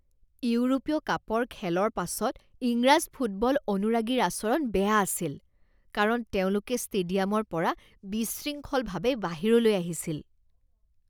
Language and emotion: Assamese, disgusted